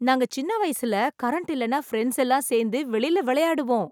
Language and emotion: Tamil, happy